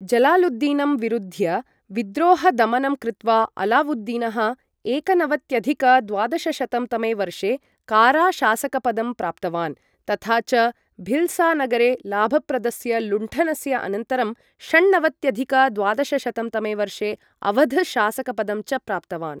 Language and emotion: Sanskrit, neutral